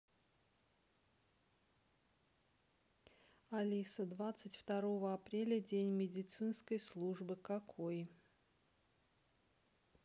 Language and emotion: Russian, neutral